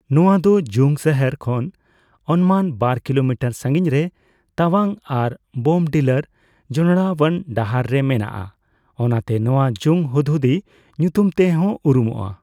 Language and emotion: Santali, neutral